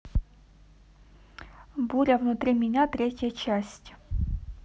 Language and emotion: Russian, neutral